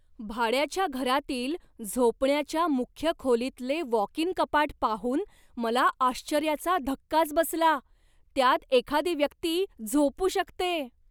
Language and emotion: Marathi, surprised